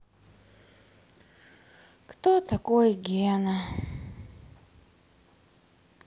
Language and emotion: Russian, sad